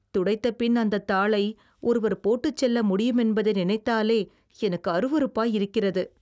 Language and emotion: Tamil, disgusted